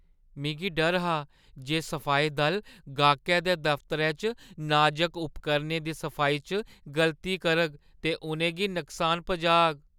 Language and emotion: Dogri, fearful